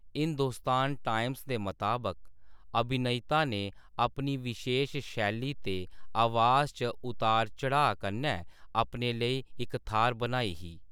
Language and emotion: Dogri, neutral